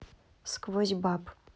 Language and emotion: Russian, neutral